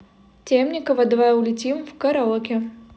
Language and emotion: Russian, neutral